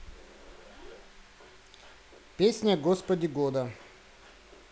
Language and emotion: Russian, neutral